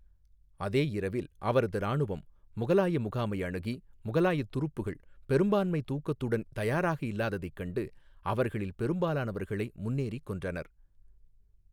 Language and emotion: Tamil, neutral